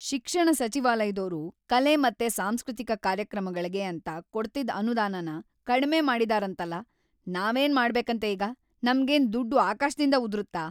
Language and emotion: Kannada, angry